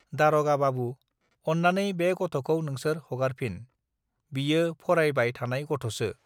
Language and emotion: Bodo, neutral